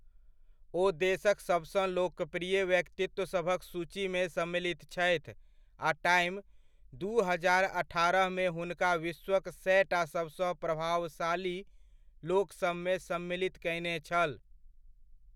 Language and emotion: Maithili, neutral